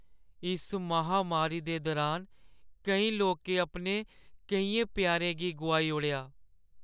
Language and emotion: Dogri, sad